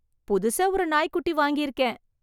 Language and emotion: Tamil, happy